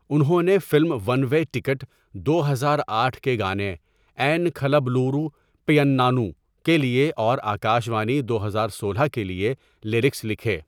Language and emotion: Urdu, neutral